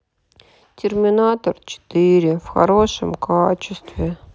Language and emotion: Russian, sad